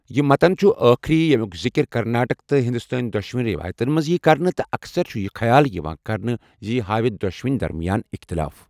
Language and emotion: Kashmiri, neutral